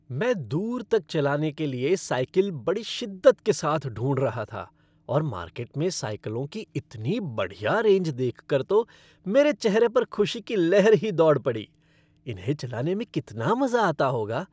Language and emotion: Hindi, happy